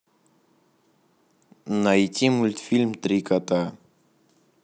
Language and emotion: Russian, neutral